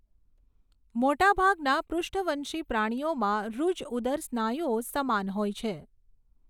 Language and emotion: Gujarati, neutral